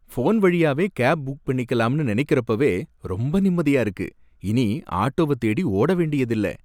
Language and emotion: Tamil, happy